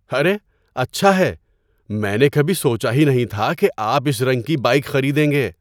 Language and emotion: Urdu, surprised